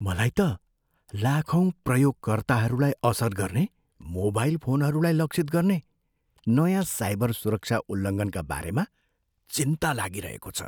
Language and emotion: Nepali, fearful